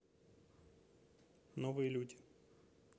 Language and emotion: Russian, neutral